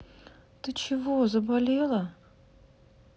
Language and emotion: Russian, sad